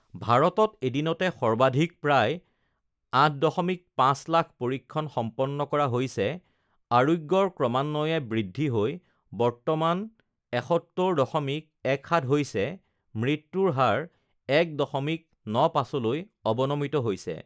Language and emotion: Assamese, neutral